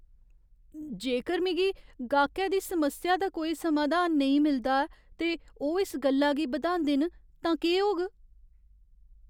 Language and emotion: Dogri, fearful